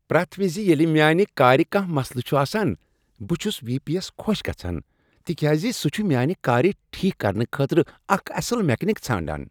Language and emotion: Kashmiri, happy